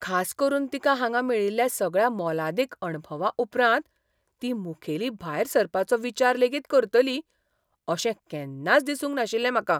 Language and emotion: Goan Konkani, surprised